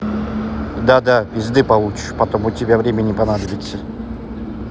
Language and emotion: Russian, neutral